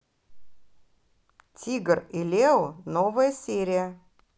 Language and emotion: Russian, positive